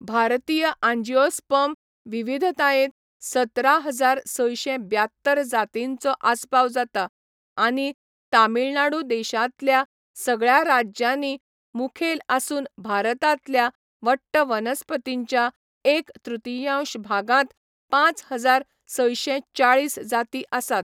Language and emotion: Goan Konkani, neutral